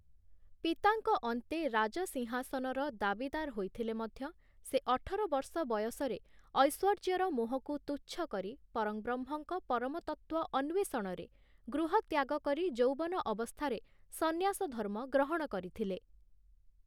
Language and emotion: Odia, neutral